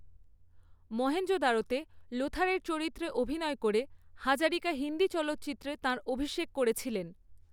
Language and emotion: Bengali, neutral